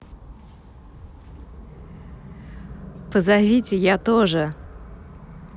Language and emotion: Russian, positive